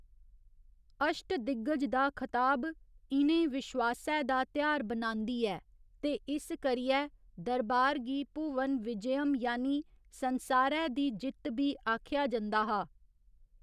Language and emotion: Dogri, neutral